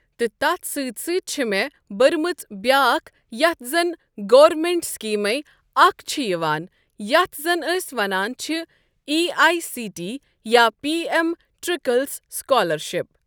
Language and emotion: Kashmiri, neutral